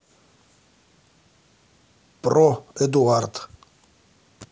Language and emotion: Russian, neutral